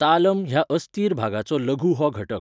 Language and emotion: Goan Konkani, neutral